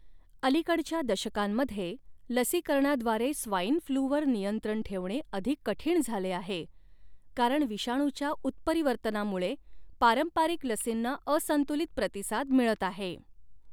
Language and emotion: Marathi, neutral